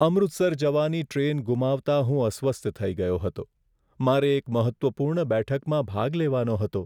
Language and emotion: Gujarati, sad